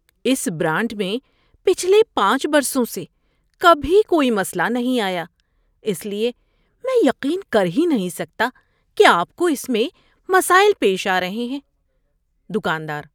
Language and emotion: Urdu, surprised